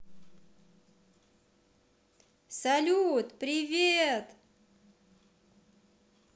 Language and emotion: Russian, positive